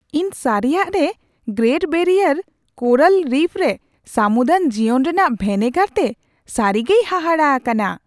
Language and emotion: Santali, surprised